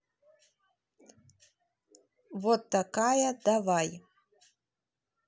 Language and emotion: Russian, neutral